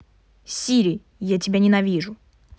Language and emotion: Russian, angry